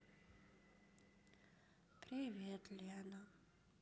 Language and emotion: Russian, sad